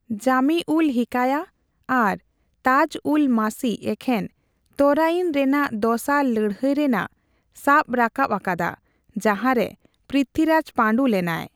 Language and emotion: Santali, neutral